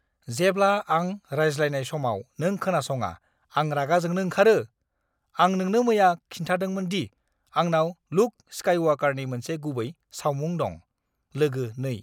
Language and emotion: Bodo, angry